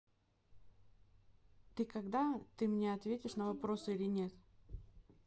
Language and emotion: Russian, neutral